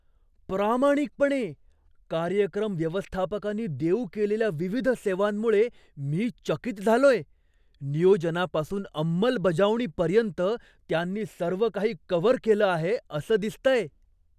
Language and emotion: Marathi, surprised